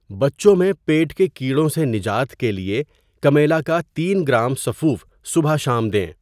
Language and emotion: Urdu, neutral